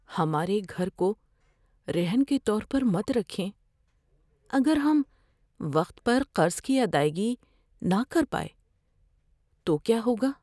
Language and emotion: Urdu, fearful